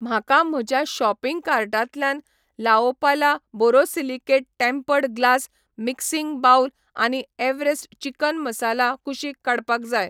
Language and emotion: Goan Konkani, neutral